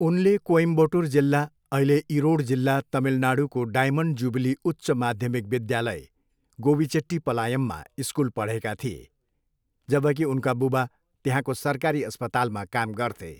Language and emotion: Nepali, neutral